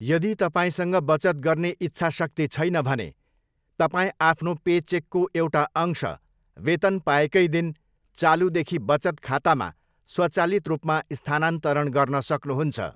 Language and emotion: Nepali, neutral